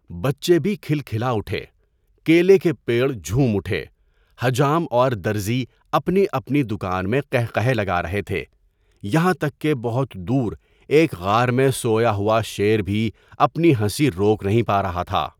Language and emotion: Urdu, neutral